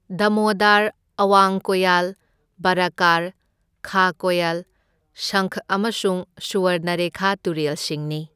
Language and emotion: Manipuri, neutral